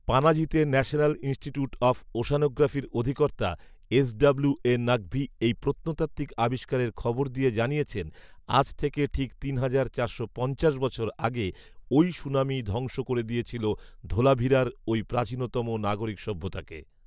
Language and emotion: Bengali, neutral